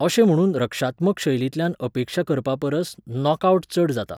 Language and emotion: Goan Konkani, neutral